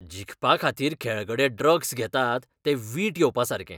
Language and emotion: Goan Konkani, disgusted